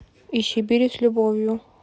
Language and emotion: Russian, neutral